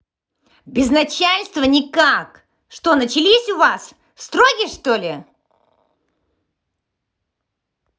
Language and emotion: Russian, angry